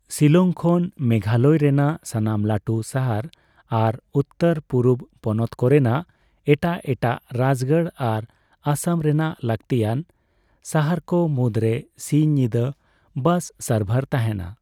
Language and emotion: Santali, neutral